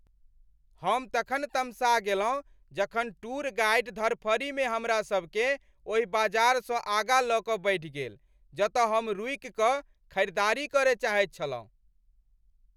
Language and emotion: Maithili, angry